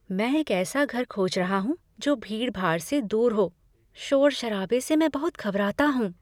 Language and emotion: Hindi, fearful